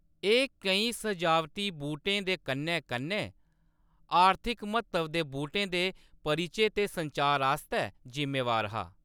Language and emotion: Dogri, neutral